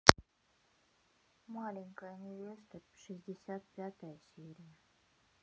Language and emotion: Russian, neutral